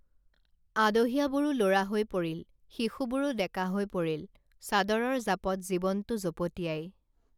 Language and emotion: Assamese, neutral